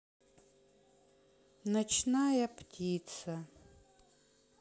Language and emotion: Russian, sad